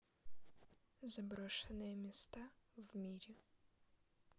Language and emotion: Russian, sad